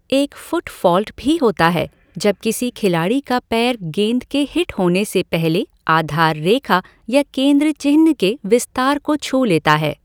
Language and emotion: Hindi, neutral